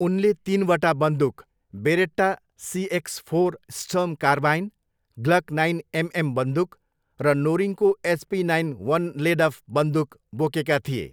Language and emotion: Nepali, neutral